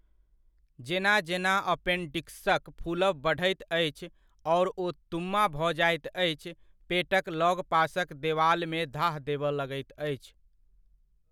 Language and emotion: Maithili, neutral